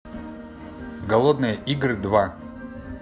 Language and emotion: Russian, neutral